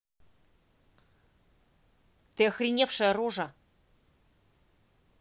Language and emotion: Russian, angry